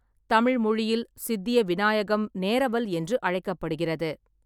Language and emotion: Tamil, neutral